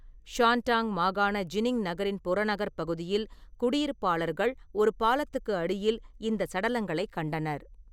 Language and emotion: Tamil, neutral